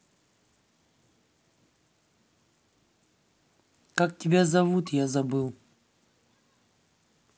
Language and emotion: Russian, neutral